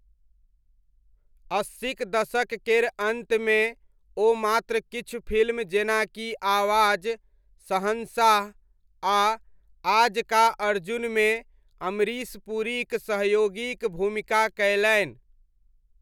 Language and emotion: Maithili, neutral